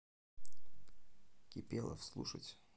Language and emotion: Russian, neutral